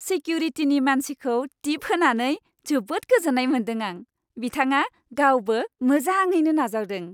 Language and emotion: Bodo, happy